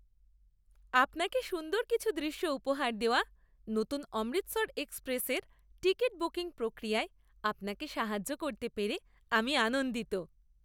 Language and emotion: Bengali, happy